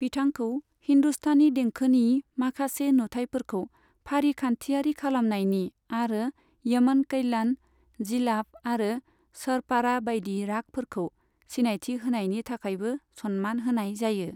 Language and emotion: Bodo, neutral